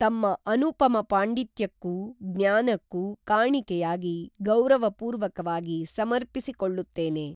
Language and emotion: Kannada, neutral